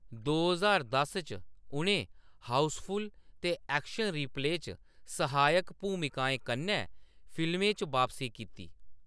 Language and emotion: Dogri, neutral